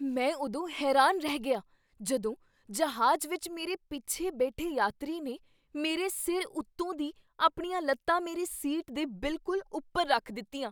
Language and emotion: Punjabi, surprised